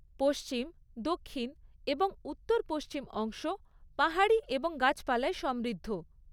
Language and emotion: Bengali, neutral